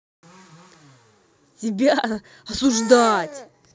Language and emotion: Russian, angry